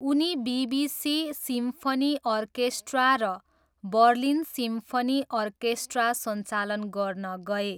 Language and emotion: Nepali, neutral